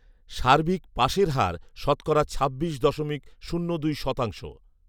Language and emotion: Bengali, neutral